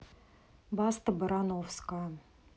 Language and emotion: Russian, neutral